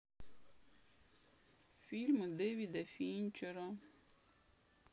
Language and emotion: Russian, sad